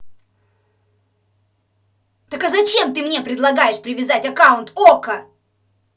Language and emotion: Russian, angry